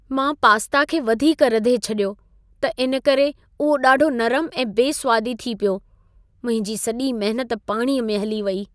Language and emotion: Sindhi, sad